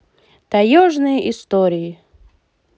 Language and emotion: Russian, positive